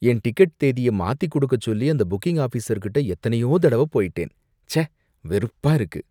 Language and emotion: Tamil, disgusted